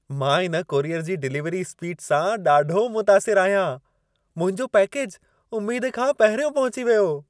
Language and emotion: Sindhi, happy